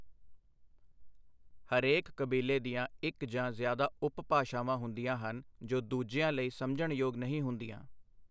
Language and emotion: Punjabi, neutral